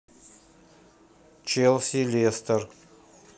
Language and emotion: Russian, neutral